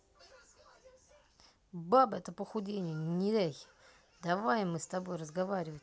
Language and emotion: Russian, angry